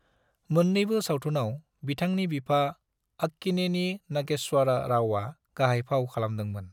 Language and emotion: Bodo, neutral